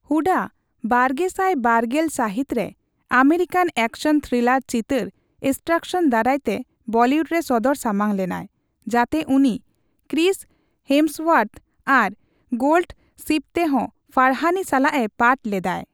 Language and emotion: Santali, neutral